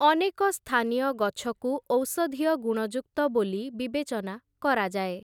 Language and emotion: Odia, neutral